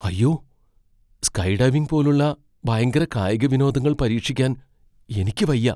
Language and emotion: Malayalam, fearful